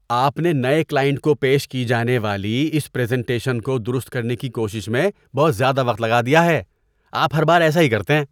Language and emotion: Urdu, disgusted